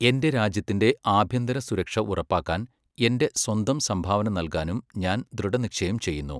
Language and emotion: Malayalam, neutral